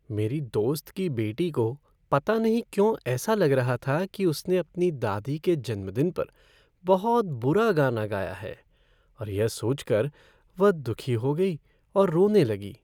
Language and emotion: Hindi, sad